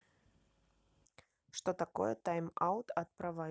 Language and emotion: Russian, neutral